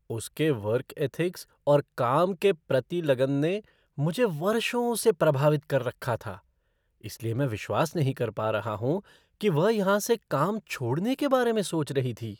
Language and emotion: Hindi, surprised